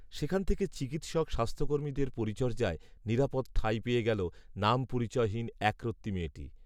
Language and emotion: Bengali, neutral